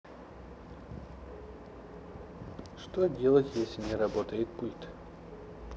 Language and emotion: Russian, neutral